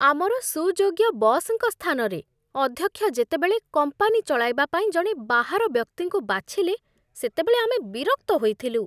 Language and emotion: Odia, disgusted